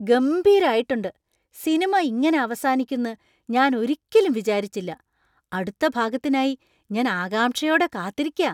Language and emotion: Malayalam, surprised